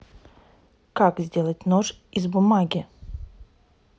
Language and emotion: Russian, neutral